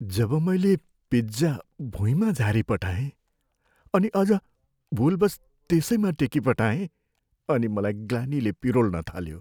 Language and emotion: Nepali, sad